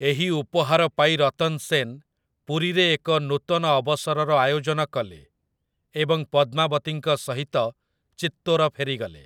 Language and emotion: Odia, neutral